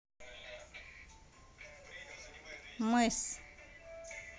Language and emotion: Russian, neutral